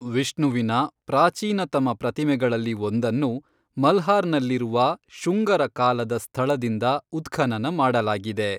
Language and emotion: Kannada, neutral